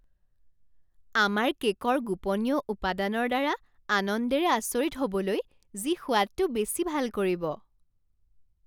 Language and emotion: Assamese, surprised